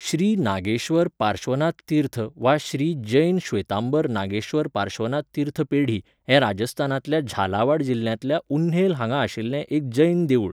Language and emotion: Goan Konkani, neutral